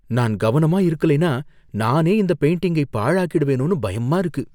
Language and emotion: Tamil, fearful